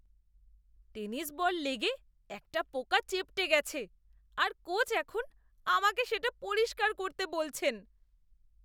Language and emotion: Bengali, disgusted